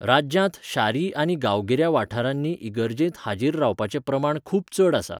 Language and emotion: Goan Konkani, neutral